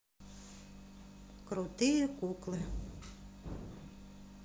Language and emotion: Russian, neutral